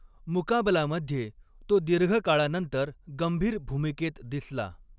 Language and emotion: Marathi, neutral